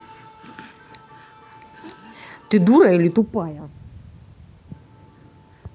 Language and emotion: Russian, angry